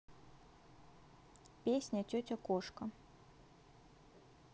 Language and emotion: Russian, neutral